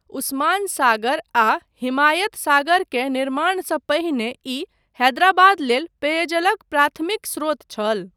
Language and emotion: Maithili, neutral